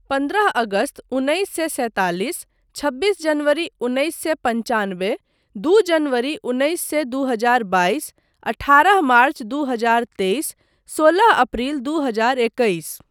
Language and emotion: Maithili, neutral